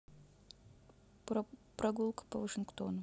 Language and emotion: Russian, neutral